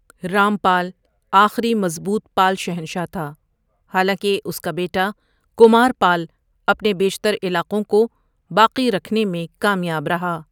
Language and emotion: Urdu, neutral